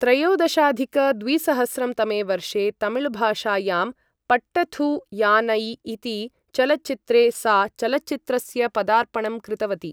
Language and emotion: Sanskrit, neutral